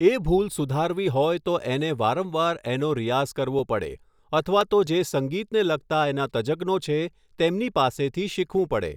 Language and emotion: Gujarati, neutral